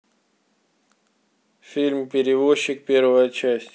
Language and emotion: Russian, neutral